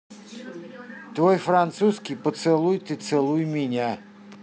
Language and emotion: Russian, neutral